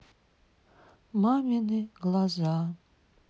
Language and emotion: Russian, sad